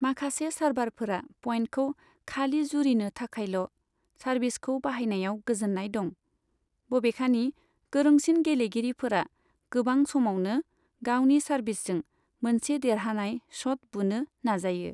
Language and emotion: Bodo, neutral